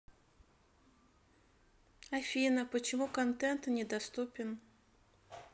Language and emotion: Russian, sad